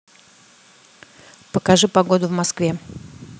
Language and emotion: Russian, neutral